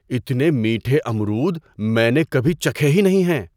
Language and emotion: Urdu, surprised